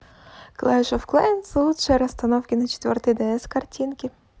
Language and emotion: Russian, positive